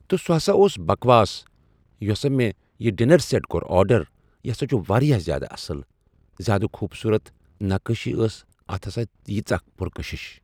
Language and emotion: Kashmiri, neutral